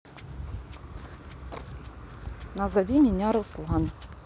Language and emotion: Russian, neutral